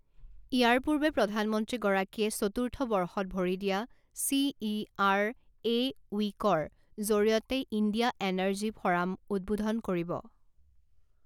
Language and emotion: Assamese, neutral